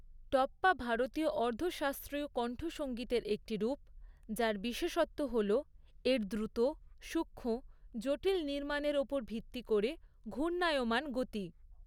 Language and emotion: Bengali, neutral